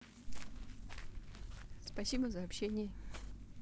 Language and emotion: Russian, positive